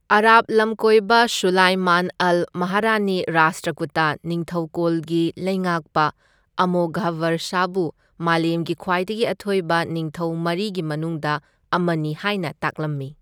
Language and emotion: Manipuri, neutral